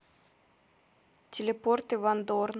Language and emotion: Russian, neutral